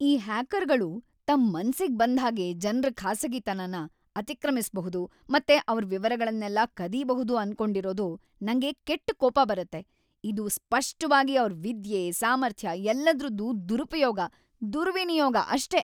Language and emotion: Kannada, angry